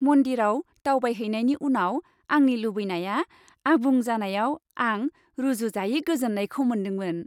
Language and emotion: Bodo, happy